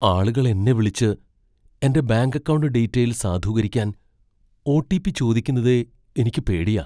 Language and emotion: Malayalam, fearful